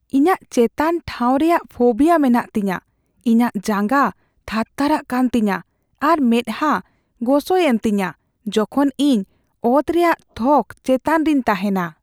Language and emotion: Santali, fearful